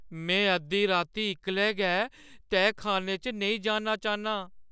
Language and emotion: Dogri, fearful